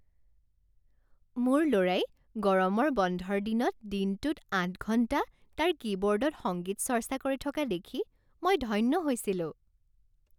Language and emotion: Assamese, happy